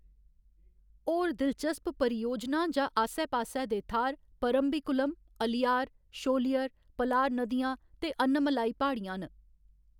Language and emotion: Dogri, neutral